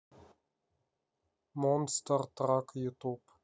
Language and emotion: Russian, neutral